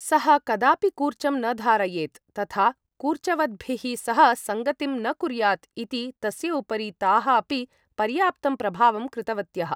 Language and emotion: Sanskrit, neutral